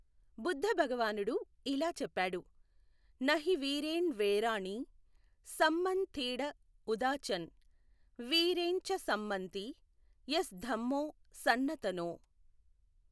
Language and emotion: Telugu, neutral